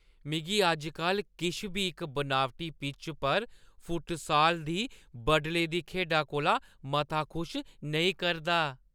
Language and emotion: Dogri, happy